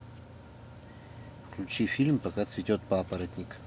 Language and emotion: Russian, neutral